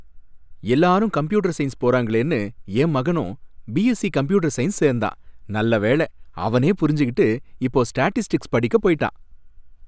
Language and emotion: Tamil, happy